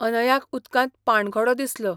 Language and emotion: Goan Konkani, neutral